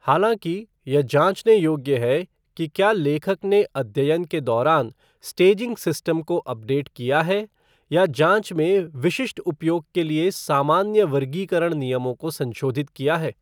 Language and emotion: Hindi, neutral